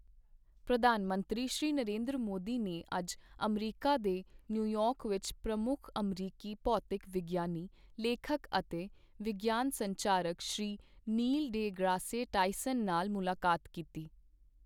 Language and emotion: Punjabi, neutral